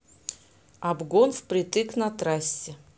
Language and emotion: Russian, neutral